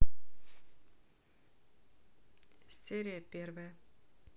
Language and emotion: Russian, neutral